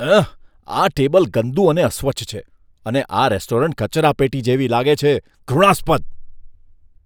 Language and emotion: Gujarati, disgusted